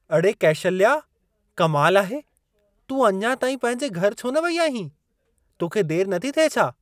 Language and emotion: Sindhi, surprised